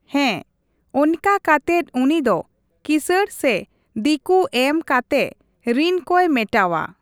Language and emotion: Santali, neutral